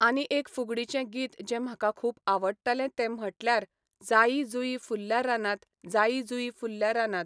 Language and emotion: Goan Konkani, neutral